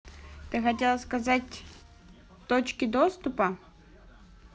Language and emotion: Russian, neutral